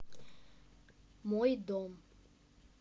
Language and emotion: Russian, neutral